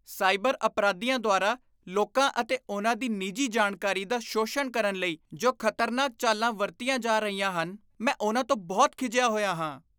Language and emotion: Punjabi, disgusted